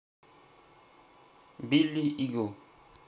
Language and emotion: Russian, neutral